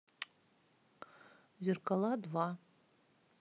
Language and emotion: Russian, neutral